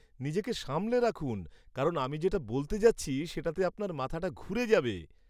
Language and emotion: Bengali, surprised